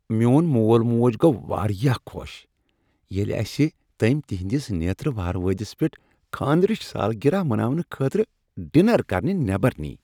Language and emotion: Kashmiri, happy